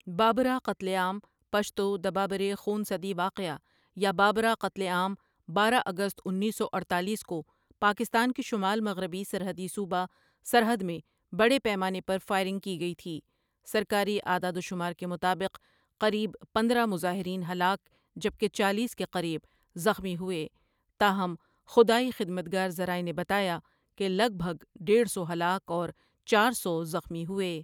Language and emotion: Urdu, neutral